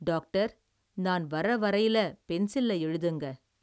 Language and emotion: Tamil, neutral